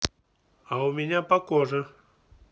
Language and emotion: Russian, neutral